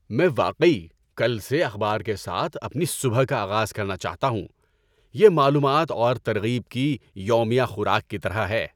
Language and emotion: Urdu, happy